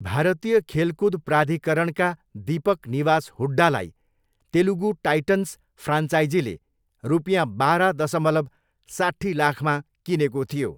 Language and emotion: Nepali, neutral